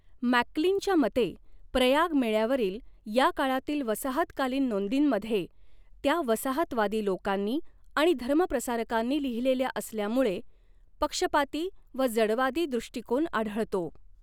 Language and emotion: Marathi, neutral